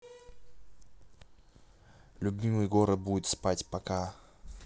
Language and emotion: Russian, neutral